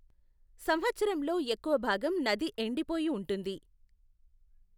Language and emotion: Telugu, neutral